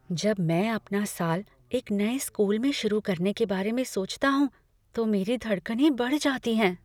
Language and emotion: Hindi, fearful